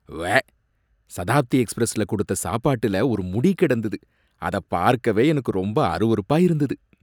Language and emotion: Tamil, disgusted